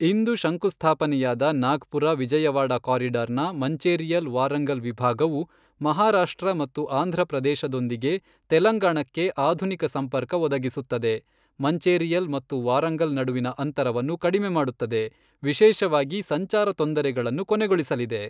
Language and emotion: Kannada, neutral